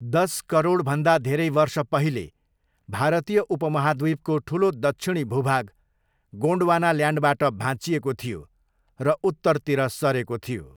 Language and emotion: Nepali, neutral